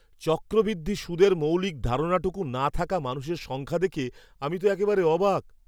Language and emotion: Bengali, surprised